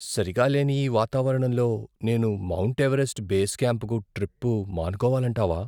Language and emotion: Telugu, fearful